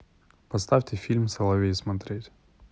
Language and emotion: Russian, neutral